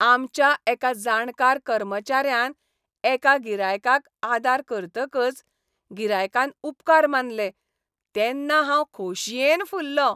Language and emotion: Goan Konkani, happy